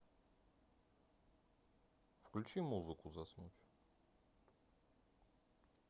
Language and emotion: Russian, neutral